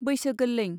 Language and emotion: Bodo, neutral